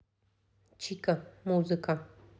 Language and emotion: Russian, neutral